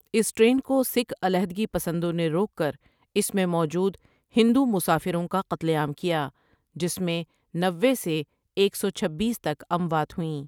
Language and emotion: Urdu, neutral